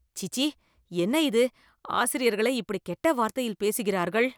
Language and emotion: Tamil, disgusted